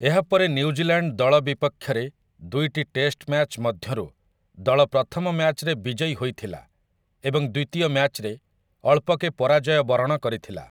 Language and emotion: Odia, neutral